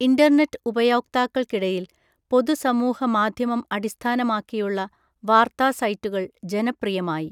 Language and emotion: Malayalam, neutral